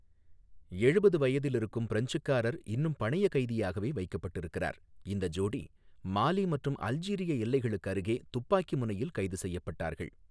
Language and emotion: Tamil, neutral